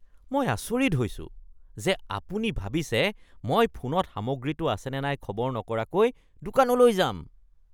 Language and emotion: Assamese, disgusted